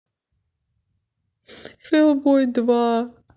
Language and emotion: Russian, sad